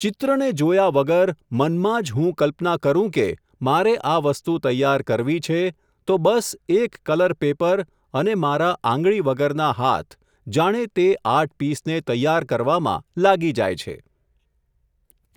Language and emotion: Gujarati, neutral